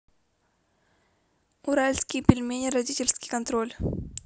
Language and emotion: Russian, neutral